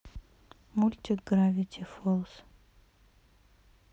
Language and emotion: Russian, neutral